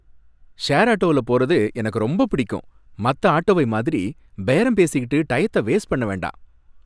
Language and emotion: Tamil, happy